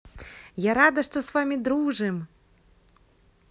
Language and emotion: Russian, positive